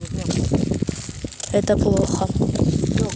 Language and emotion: Russian, neutral